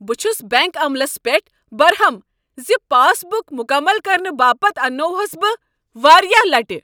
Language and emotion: Kashmiri, angry